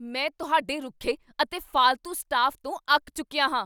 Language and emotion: Punjabi, angry